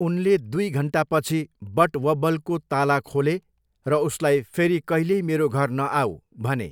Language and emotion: Nepali, neutral